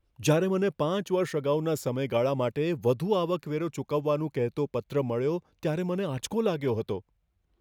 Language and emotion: Gujarati, fearful